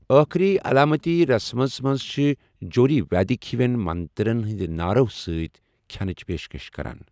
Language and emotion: Kashmiri, neutral